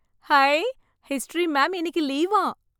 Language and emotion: Tamil, happy